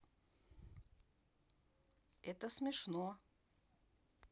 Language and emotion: Russian, neutral